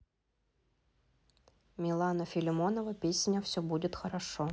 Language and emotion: Russian, neutral